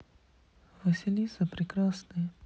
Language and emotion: Russian, sad